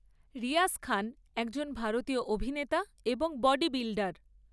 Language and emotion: Bengali, neutral